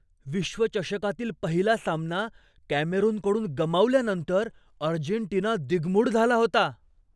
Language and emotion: Marathi, surprised